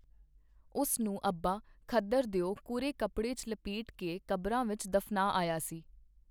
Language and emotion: Punjabi, neutral